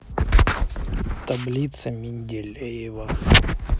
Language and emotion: Russian, neutral